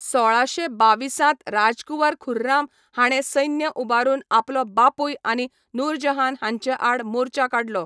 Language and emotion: Goan Konkani, neutral